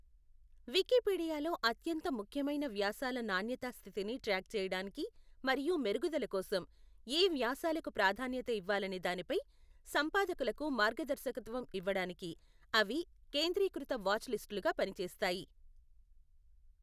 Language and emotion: Telugu, neutral